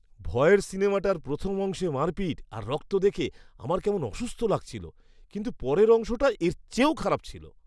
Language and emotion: Bengali, disgusted